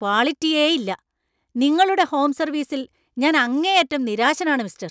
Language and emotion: Malayalam, angry